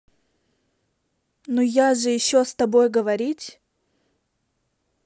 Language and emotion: Russian, angry